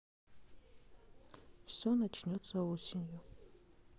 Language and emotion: Russian, sad